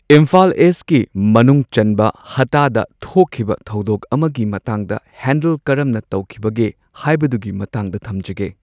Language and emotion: Manipuri, neutral